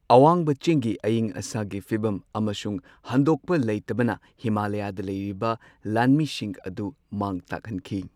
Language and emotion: Manipuri, neutral